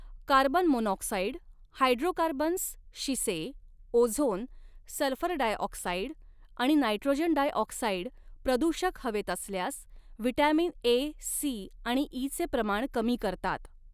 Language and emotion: Marathi, neutral